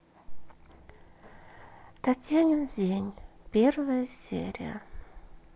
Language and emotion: Russian, sad